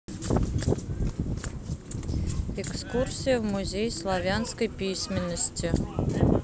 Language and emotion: Russian, neutral